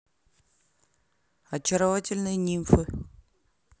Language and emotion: Russian, neutral